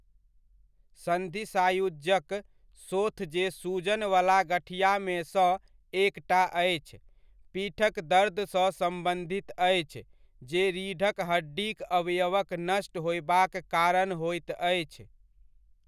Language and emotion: Maithili, neutral